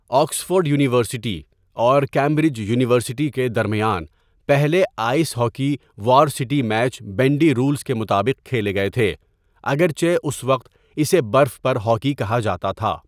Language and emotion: Urdu, neutral